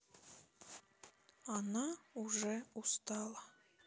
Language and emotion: Russian, sad